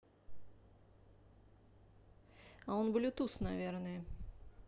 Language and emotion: Russian, neutral